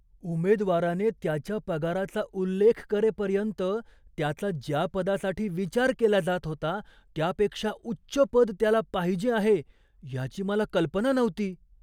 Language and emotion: Marathi, surprised